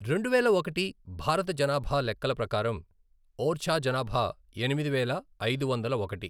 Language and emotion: Telugu, neutral